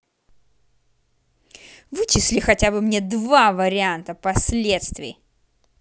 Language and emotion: Russian, angry